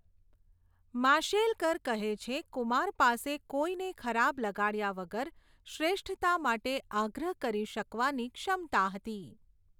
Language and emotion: Gujarati, neutral